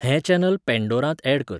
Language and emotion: Goan Konkani, neutral